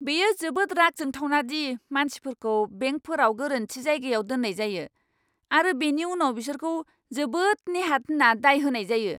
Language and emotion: Bodo, angry